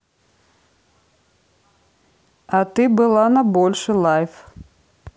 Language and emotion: Russian, neutral